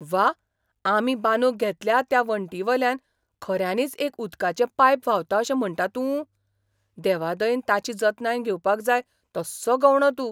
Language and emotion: Goan Konkani, surprised